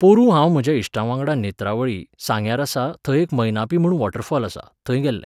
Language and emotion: Goan Konkani, neutral